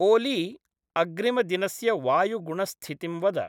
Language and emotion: Sanskrit, neutral